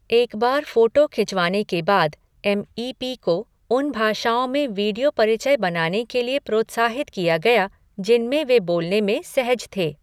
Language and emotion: Hindi, neutral